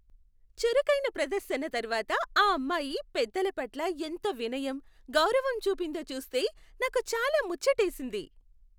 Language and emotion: Telugu, happy